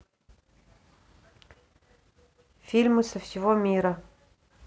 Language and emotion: Russian, neutral